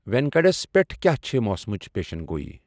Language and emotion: Kashmiri, neutral